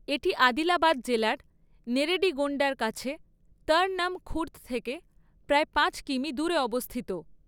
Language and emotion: Bengali, neutral